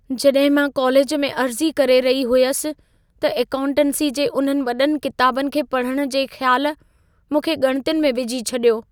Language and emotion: Sindhi, fearful